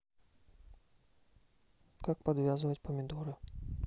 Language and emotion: Russian, neutral